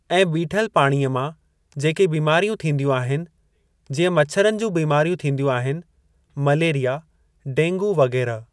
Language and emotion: Sindhi, neutral